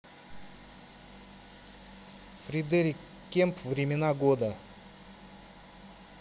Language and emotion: Russian, neutral